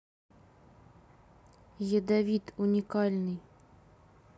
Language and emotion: Russian, neutral